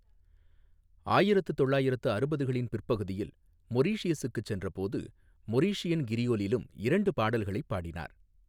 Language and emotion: Tamil, neutral